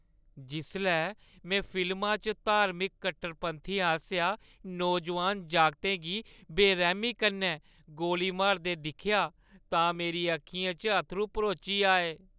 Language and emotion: Dogri, sad